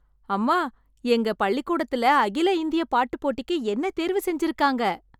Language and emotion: Tamil, happy